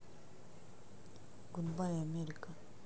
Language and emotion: Russian, neutral